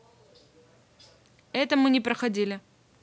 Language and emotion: Russian, neutral